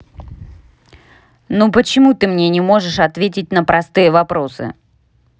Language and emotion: Russian, angry